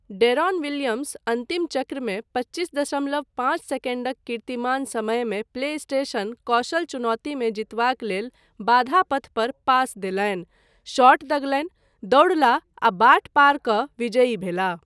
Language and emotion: Maithili, neutral